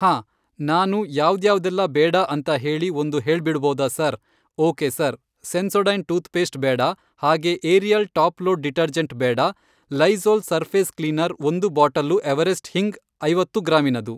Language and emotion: Kannada, neutral